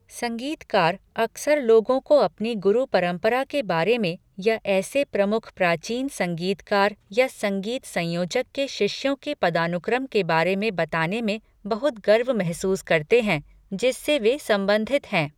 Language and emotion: Hindi, neutral